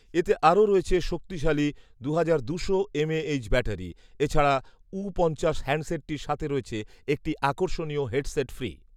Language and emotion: Bengali, neutral